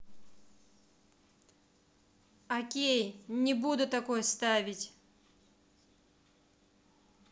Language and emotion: Russian, angry